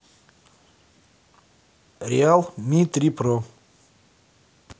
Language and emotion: Russian, neutral